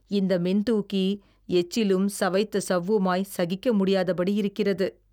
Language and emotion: Tamil, disgusted